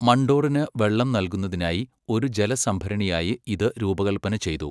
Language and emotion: Malayalam, neutral